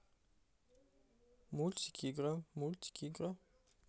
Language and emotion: Russian, neutral